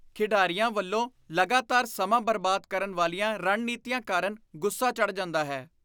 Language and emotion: Punjabi, disgusted